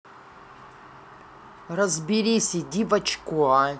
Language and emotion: Russian, angry